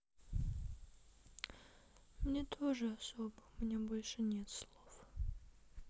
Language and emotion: Russian, sad